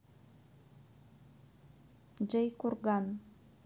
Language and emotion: Russian, neutral